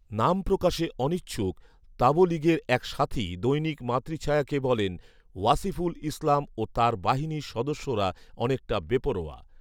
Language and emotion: Bengali, neutral